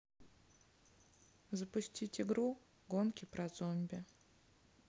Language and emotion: Russian, neutral